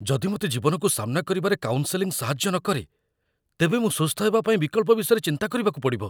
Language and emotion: Odia, fearful